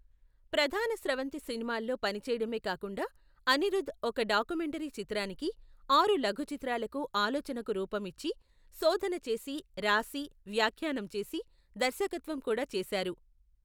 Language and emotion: Telugu, neutral